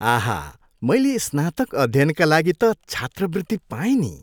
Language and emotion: Nepali, happy